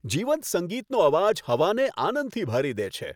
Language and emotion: Gujarati, happy